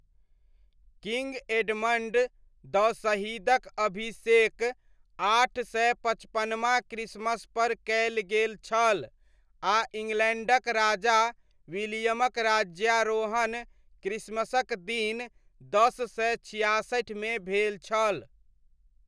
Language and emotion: Maithili, neutral